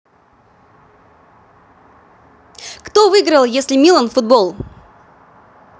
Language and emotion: Russian, positive